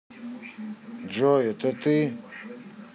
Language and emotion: Russian, neutral